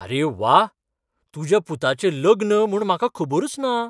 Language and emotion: Goan Konkani, surprised